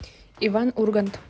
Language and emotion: Russian, neutral